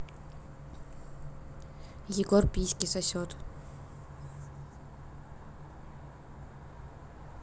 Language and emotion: Russian, neutral